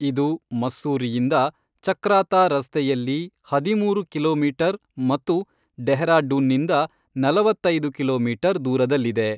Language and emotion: Kannada, neutral